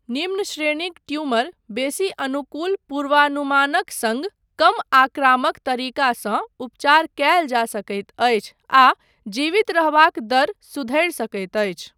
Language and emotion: Maithili, neutral